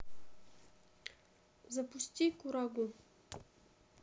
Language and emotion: Russian, neutral